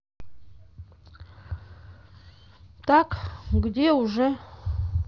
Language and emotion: Russian, neutral